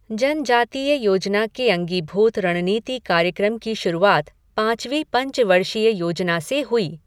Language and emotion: Hindi, neutral